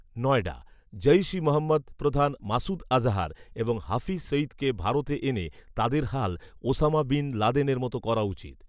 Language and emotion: Bengali, neutral